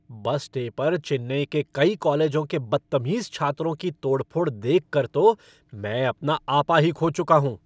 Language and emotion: Hindi, angry